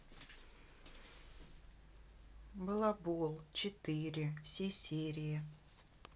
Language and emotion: Russian, neutral